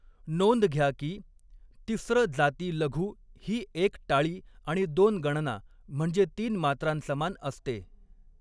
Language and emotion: Marathi, neutral